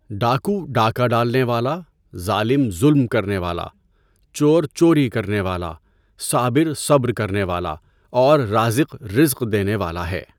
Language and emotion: Urdu, neutral